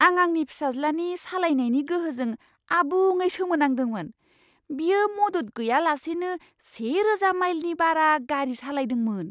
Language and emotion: Bodo, surprised